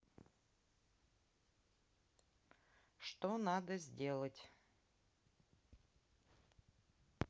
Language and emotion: Russian, neutral